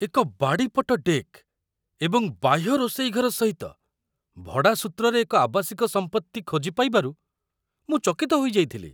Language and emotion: Odia, surprised